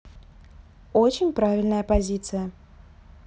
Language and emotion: Russian, neutral